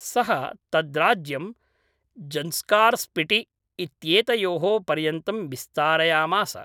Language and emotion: Sanskrit, neutral